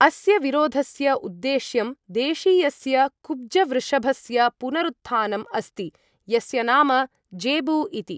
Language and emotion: Sanskrit, neutral